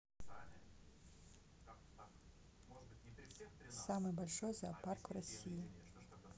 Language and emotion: Russian, neutral